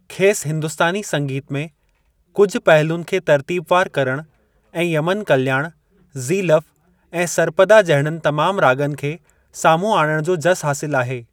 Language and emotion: Sindhi, neutral